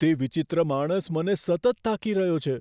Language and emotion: Gujarati, fearful